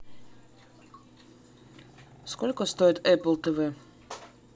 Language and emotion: Russian, neutral